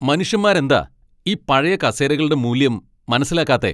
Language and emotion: Malayalam, angry